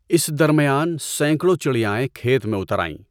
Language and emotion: Urdu, neutral